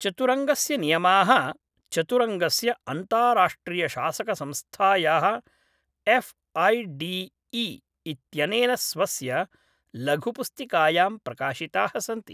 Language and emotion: Sanskrit, neutral